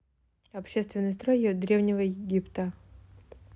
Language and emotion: Russian, neutral